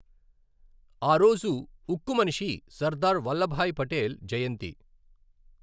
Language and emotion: Telugu, neutral